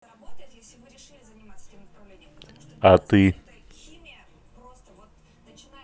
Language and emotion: Russian, neutral